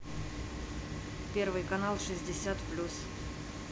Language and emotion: Russian, neutral